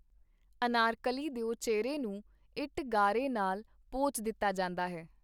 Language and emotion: Punjabi, neutral